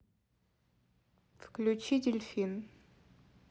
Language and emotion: Russian, neutral